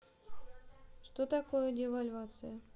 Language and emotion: Russian, neutral